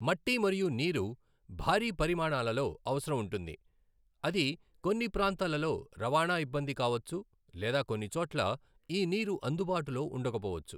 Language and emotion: Telugu, neutral